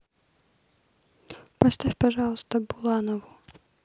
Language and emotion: Russian, neutral